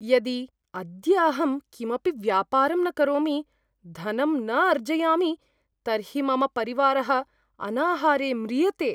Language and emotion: Sanskrit, fearful